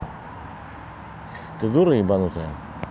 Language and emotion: Russian, angry